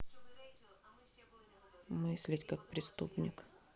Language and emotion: Russian, neutral